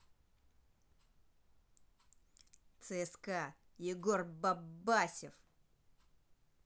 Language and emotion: Russian, angry